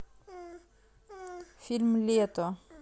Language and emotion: Russian, neutral